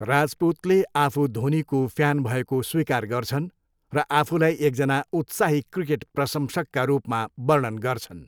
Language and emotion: Nepali, neutral